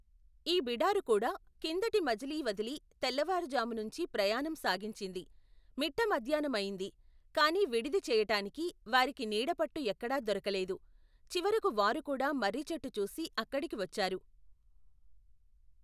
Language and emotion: Telugu, neutral